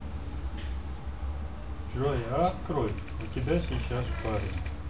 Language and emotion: Russian, neutral